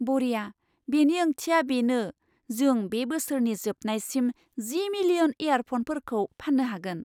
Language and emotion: Bodo, surprised